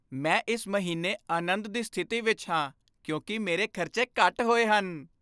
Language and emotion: Punjabi, happy